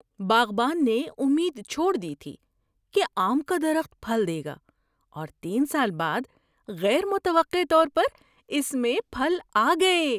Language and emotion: Urdu, surprised